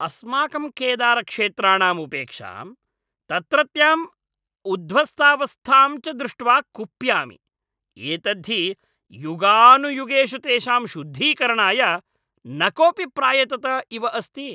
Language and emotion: Sanskrit, angry